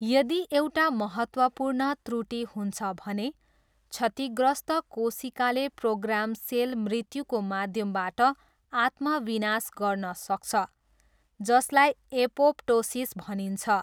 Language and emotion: Nepali, neutral